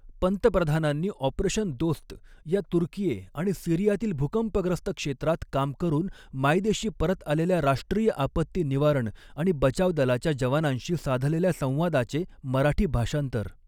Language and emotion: Marathi, neutral